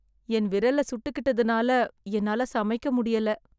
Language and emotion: Tamil, sad